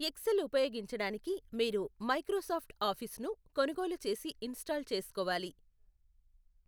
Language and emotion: Telugu, neutral